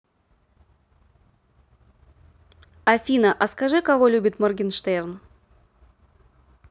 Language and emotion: Russian, neutral